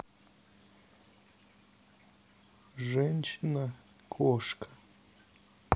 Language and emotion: Russian, neutral